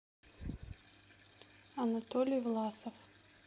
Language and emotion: Russian, neutral